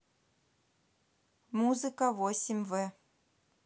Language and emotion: Russian, neutral